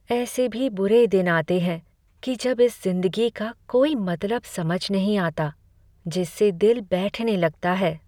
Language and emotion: Hindi, sad